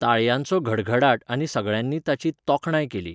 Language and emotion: Goan Konkani, neutral